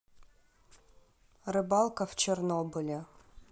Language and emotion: Russian, neutral